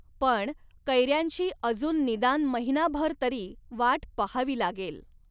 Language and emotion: Marathi, neutral